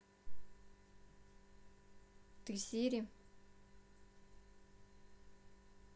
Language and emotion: Russian, neutral